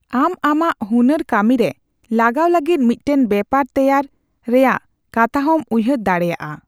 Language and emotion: Santali, neutral